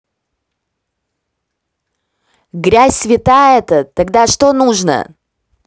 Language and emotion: Russian, neutral